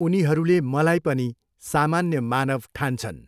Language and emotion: Nepali, neutral